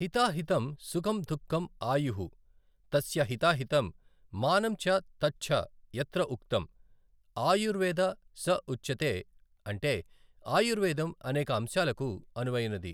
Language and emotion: Telugu, neutral